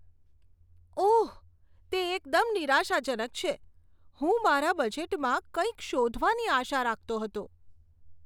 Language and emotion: Gujarati, disgusted